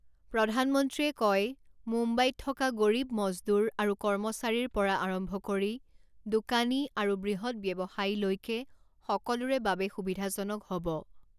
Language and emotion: Assamese, neutral